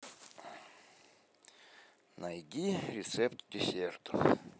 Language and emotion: Russian, neutral